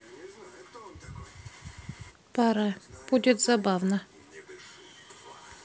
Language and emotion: Russian, neutral